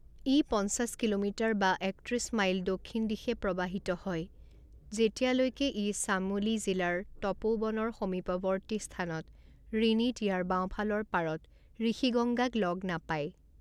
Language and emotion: Assamese, neutral